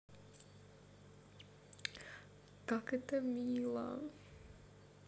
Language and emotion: Russian, positive